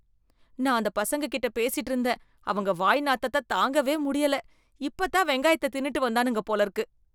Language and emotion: Tamil, disgusted